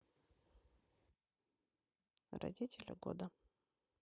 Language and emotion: Russian, neutral